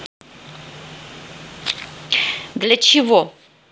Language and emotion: Russian, neutral